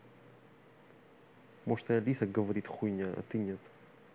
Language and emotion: Russian, angry